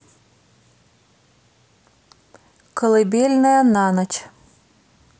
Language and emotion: Russian, neutral